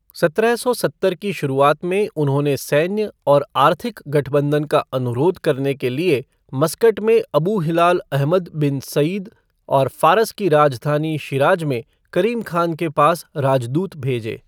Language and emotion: Hindi, neutral